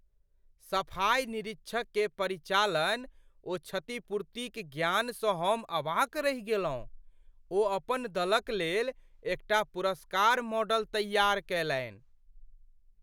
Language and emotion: Maithili, surprised